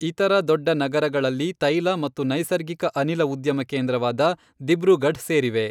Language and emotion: Kannada, neutral